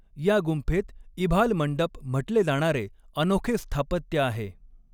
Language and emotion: Marathi, neutral